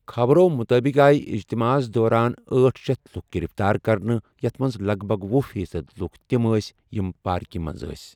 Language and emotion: Kashmiri, neutral